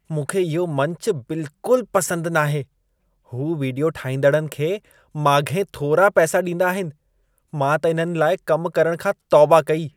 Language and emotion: Sindhi, disgusted